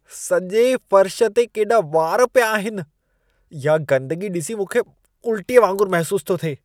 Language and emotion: Sindhi, disgusted